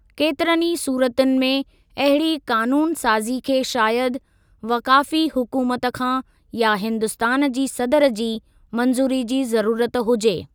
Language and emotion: Sindhi, neutral